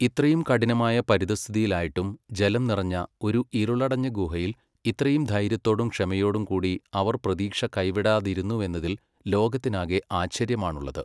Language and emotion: Malayalam, neutral